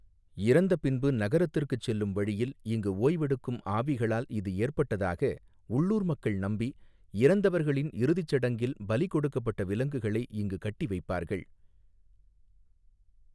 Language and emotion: Tamil, neutral